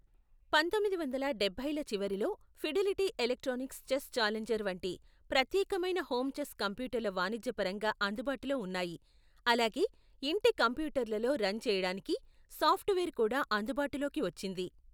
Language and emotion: Telugu, neutral